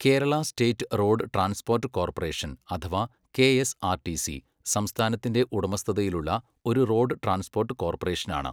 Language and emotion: Malayalam, neutral